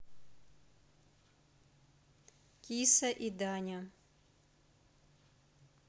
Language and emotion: Russian, neutral